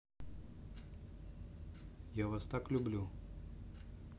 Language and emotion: Russian, neutral